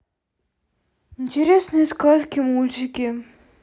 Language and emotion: Russian, sad